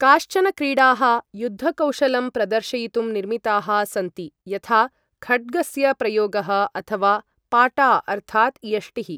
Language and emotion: Sanskrit, neutral